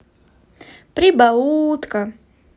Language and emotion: Russian, positive